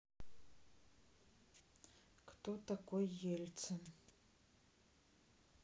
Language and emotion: Russian, neutral